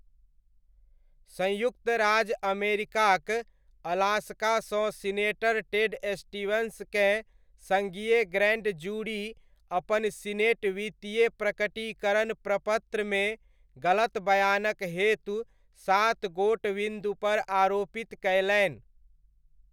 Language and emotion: Maithili, neutral